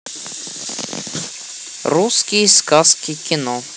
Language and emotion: Russian, neutral